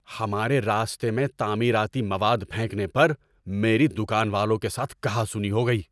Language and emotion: Urdu, angry